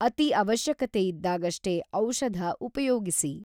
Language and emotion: Kannada, neutral